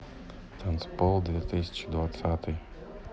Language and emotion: Russian, neutral